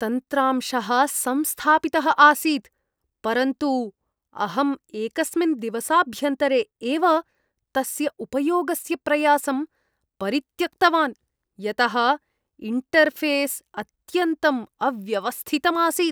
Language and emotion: Sanskrit, disgusted